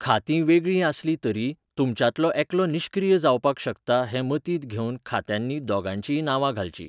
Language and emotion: Goan Konkani, neutral